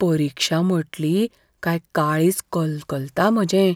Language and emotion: Goan Konkani, fearful